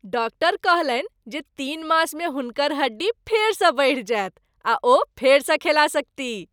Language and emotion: Maithili, happy